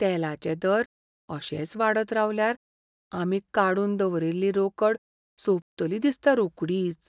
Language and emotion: Goan Konkani, fearful